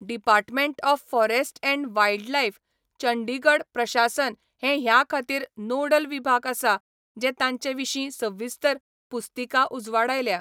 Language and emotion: Goan Konkani, neutral